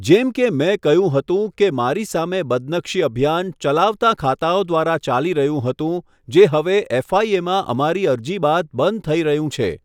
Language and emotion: Gujarati, neutral